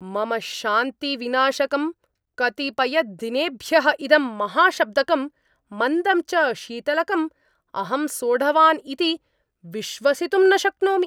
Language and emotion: Sanskrit, angry